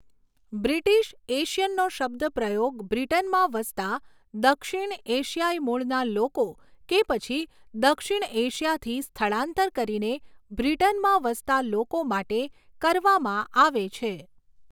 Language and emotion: Gujarati, neutral